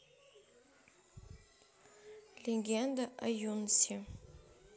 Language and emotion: Russian, neutral